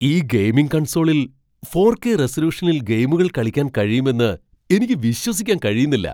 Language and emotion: Malayalam, surprised